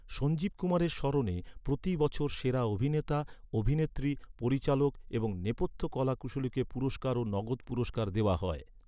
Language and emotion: Bengali, neutral